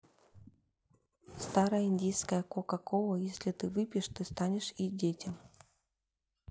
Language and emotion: Russian, neutral